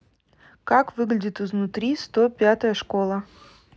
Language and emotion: Russian, neutral